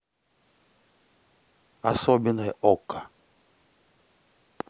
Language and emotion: Russian, neutral